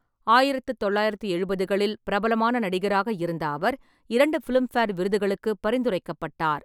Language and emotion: Tamil, neutral